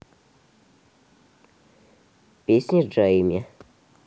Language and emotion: Russian, neutral